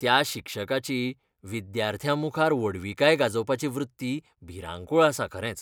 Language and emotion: Goan Konkani, disgusted